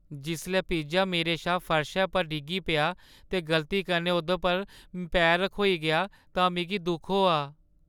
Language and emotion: Dogri, sad